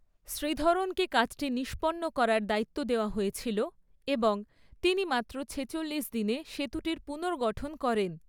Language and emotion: Bengali, neutral